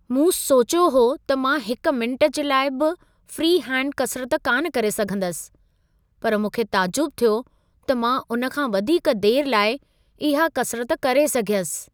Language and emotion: Sindhi, surprised